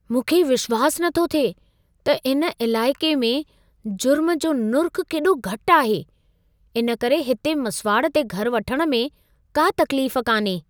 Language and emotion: Sindhi, surprised